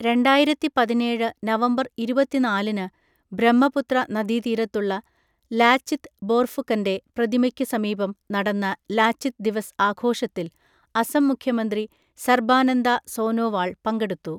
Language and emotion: Malayalam, neutral